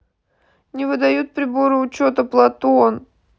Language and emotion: Russian, sad